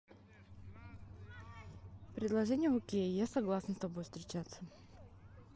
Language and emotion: Russian, neutral